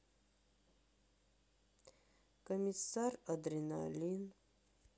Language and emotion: Russian, sad